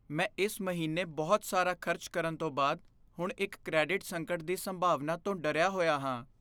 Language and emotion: Punjabi, fearful